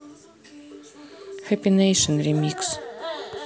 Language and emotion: Russian, neutral